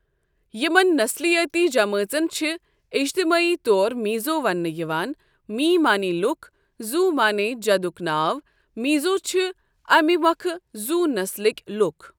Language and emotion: Kashmiri, neutral